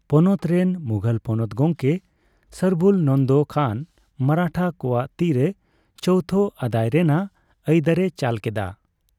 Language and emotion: Santali, neutral